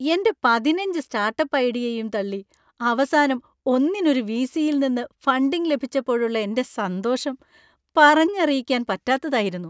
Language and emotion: Malayalam, happy